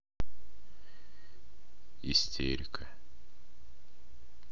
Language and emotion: Russian, neutral